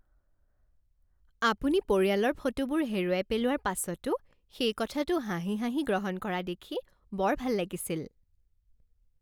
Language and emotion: Assamese, happy